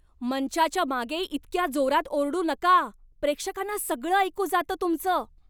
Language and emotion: Marathi, angry